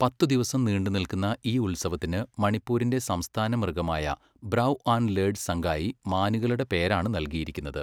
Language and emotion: Malayalam, neutral